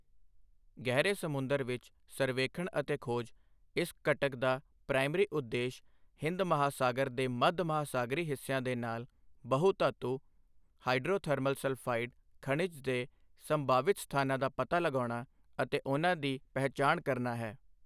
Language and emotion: Punjabi, neutral